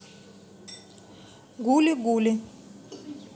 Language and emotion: Russian, neutral